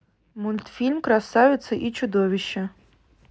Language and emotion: Russian, neutral